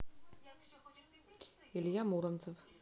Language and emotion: Russian, neutral